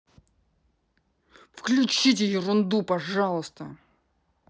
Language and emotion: Russian, angry